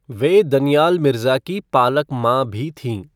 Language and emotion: Hindi, neutral